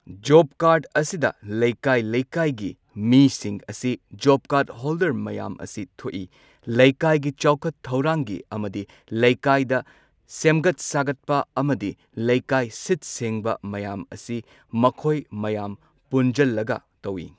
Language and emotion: Manipuri, neutral